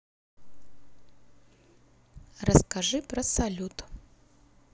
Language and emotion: Russian, neutral